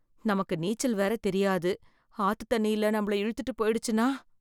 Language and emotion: Tamil, fearful